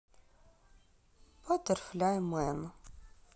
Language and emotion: Russian, sad